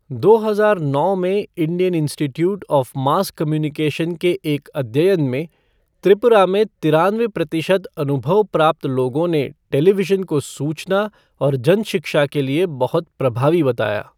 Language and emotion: Hindi, neutral